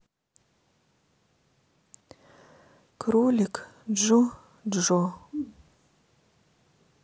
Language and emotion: Russian, sad